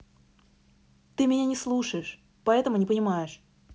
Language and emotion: Russian, angry